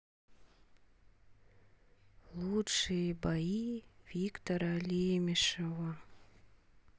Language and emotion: Russian, sad